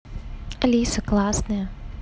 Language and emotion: Russian, neutral